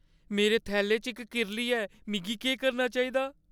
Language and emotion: Dogri, fearful